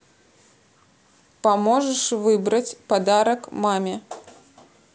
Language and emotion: Russian, neutral